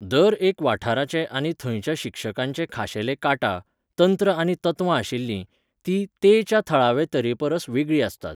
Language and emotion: Goan Konkani, neutral